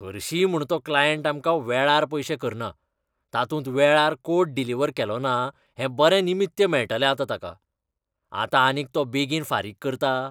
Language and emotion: Goan Konkani, disgusted